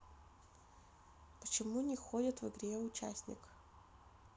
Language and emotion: Russian, neutral